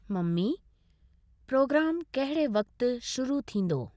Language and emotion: Sindhi, neutral